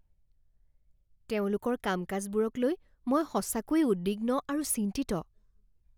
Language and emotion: Assamese, fearful